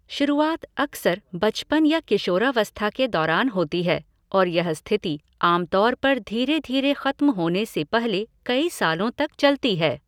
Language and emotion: Hindi, neutral